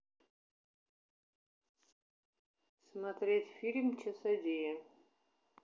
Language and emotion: Russian, neutral